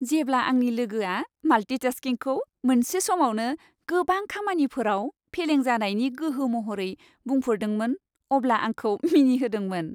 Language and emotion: Bodo, happy